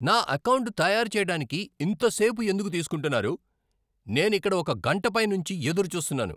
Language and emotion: Telugu, angry